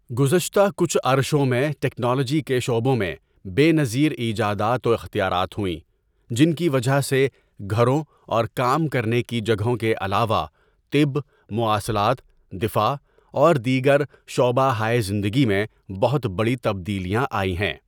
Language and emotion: Urdu, neutral